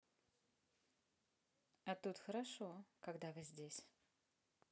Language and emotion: Russian, positive